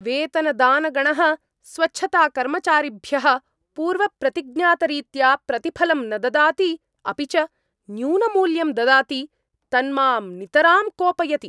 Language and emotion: Sanskrit, angry